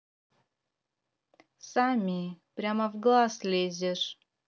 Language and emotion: Russian, neutral